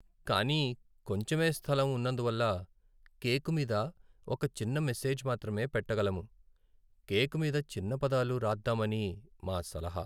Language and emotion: Telugu, sad